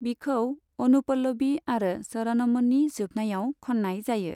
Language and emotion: Bodo, neutral